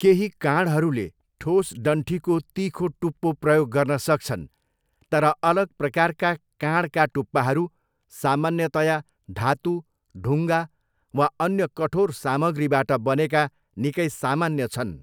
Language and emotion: Nepali, neutral